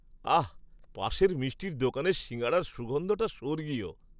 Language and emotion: Bengali, happy